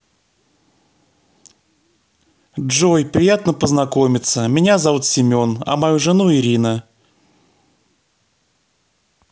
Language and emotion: Russian, neutral